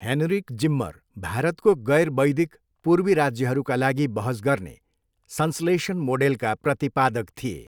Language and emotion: Nepali, neutral